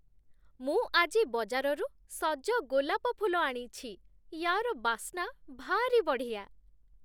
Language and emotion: Odia, happy